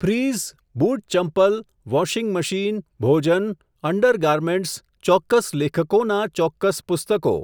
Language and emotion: Gujarati, neutral